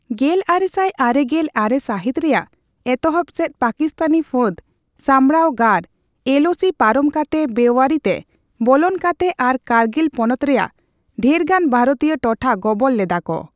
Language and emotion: Santali, neutral